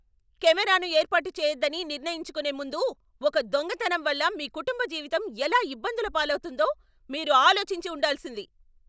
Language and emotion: Telugu, angry